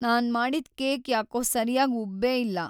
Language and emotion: Kannada, sad